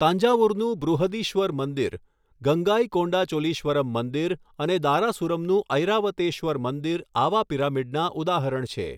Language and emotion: Gujarati, neutral